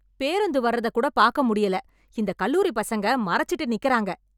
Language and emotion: Tamil, angry